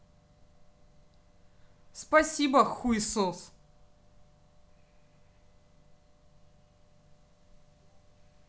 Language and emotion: Russian, angry